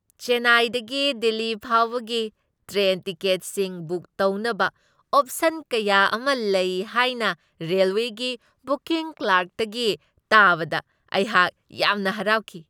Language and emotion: Manipuri, happy